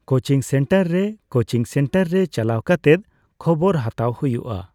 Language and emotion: Santali, neutral